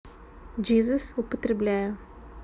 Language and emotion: Russian, neutral